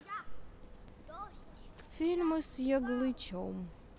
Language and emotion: Russian, neutral